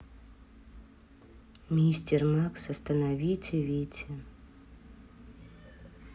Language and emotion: Russian, neutral